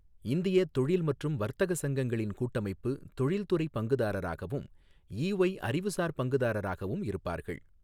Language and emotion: Tamil, neutral